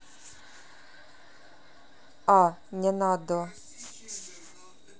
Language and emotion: Russian, neutral